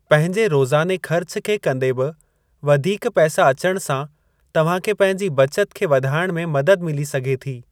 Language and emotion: Sindhi, neutral